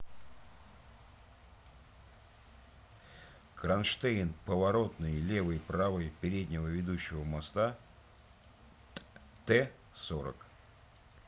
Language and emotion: Russian, neutral